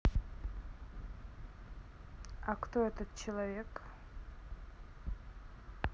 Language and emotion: Russian, neutral